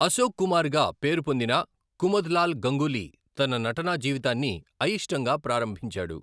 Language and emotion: Telugu, neutral